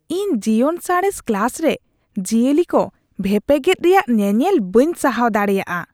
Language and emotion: Santali, disgusted